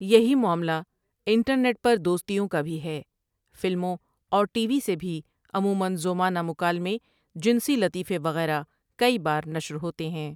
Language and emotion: Urdu, neutral